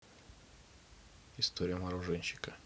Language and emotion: Russian, neutral